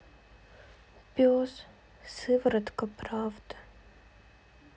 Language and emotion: Russian, sad